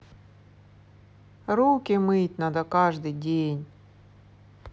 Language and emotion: Russian, sad